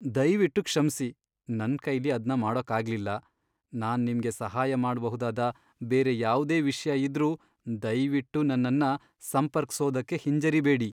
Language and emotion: Kannada, sad